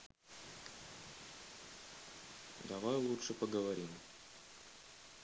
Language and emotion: Russian, neutral